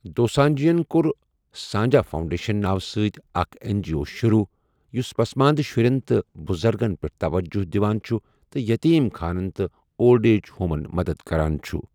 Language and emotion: Kashmiri, neutral